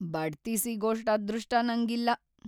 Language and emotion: Kannada, sad